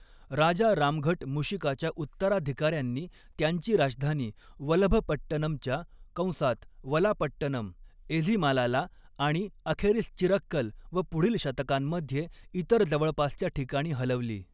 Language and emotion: Marathi, neutral